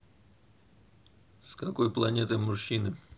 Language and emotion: Russian, neutral